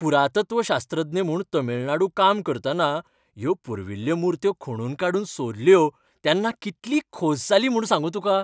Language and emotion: Goan Konkani, happy